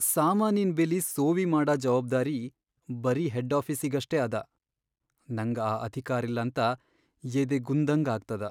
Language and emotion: Kannada, sad